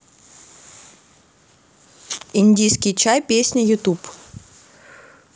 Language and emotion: Russian, neutral